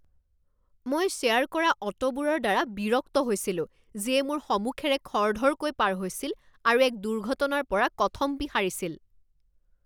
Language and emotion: Assamese, angry